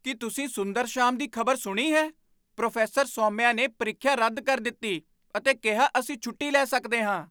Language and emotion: Punjabi, surprised